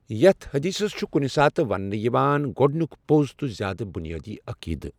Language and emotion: Kashmiri, neutral